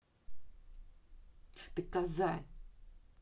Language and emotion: Russian, angry